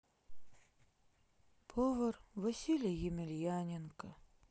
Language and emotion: Russian, sad